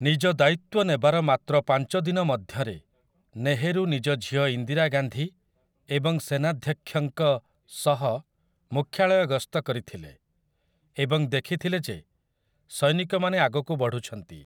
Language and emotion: Odia, neutral